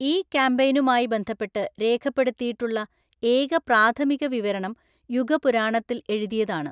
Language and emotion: Malayalam, neutral